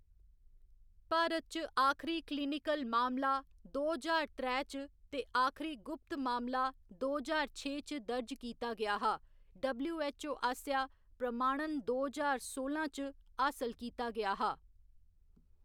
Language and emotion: Dogri, neutral